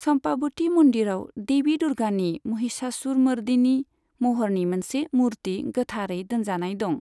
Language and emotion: Bodo, neutral